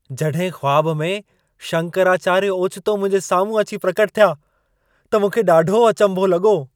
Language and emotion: Sindhi, surprised